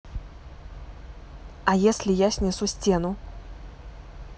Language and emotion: Russian, neutral